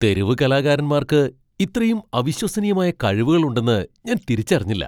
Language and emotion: Malayalam, surprised